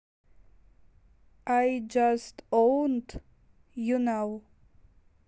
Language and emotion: Russian, neutral